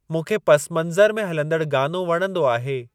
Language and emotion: Sindhi, neutral